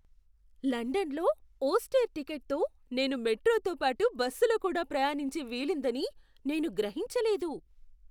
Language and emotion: Telugu, surprised